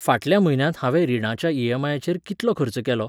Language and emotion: Goan Konkani, neutral